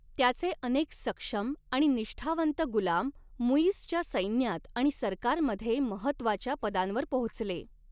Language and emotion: Marathi, neutral